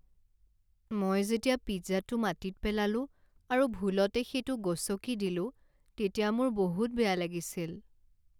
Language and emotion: Assamese, sad